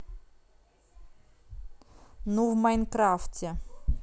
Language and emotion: Russian, neutral